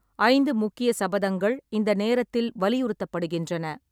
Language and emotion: Tamil, neutral